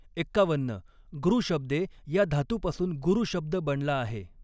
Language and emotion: Marathi, neutral